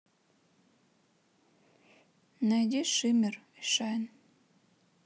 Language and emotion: Russian, sad